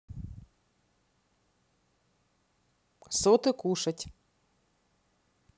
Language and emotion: Russian, neutral